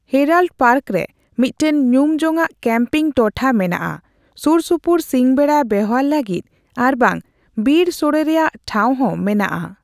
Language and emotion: Santali, neutral